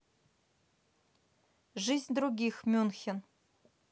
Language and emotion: Russian, neutral